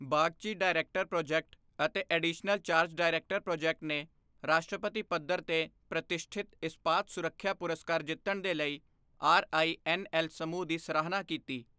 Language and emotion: Punjabi, neutral